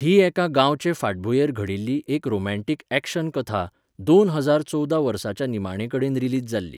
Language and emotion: Goan Konkani, neutral